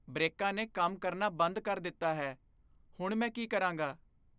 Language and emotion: Punjabi, fearful